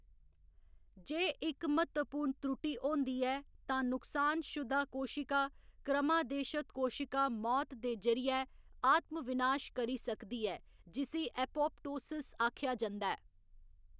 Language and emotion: Dogri, neutral